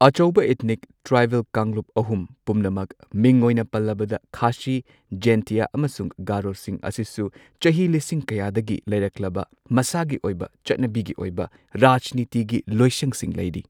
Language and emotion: Manipuri, neutral